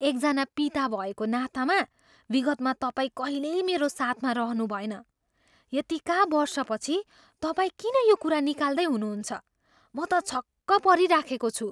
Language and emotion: Nepali, surprised